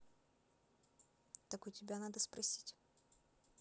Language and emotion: Russian, neutral